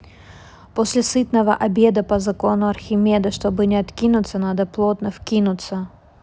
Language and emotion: Russian, neutral